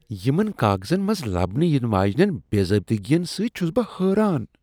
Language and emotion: Kashmiri, disgusted